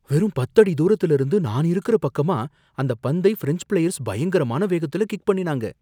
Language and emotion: Tamil, fearful